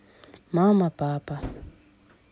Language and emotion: Russian, neutral